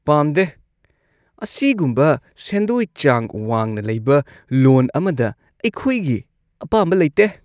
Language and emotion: Manipuri, disgusted